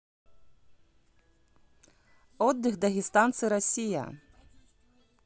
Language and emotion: Russian, neutral